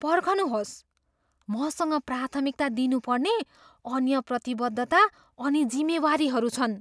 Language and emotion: Nepali, surprised